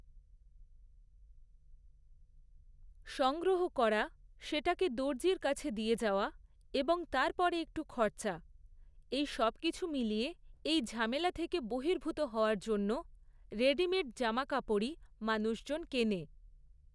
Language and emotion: Bengali, neutral